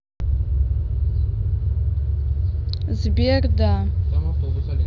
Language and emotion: Russian, neutral